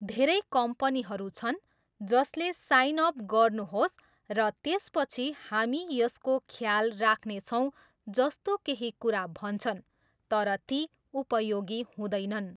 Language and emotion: Nepali, neutral